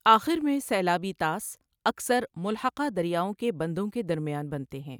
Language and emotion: Urdu, neutral